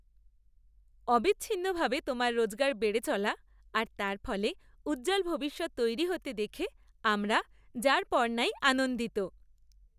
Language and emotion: Bengali, happy